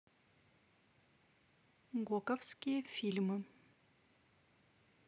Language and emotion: Russian, neutral